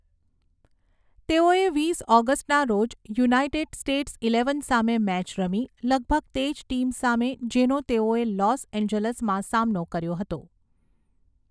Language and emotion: Gujarati, neutral